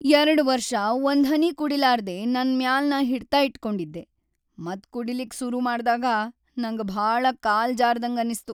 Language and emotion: Kannada, sad